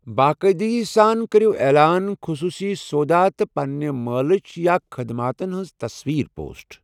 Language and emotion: Kashmiri, neutral